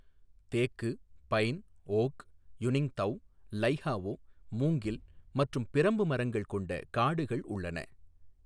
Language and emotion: Tamil, neutral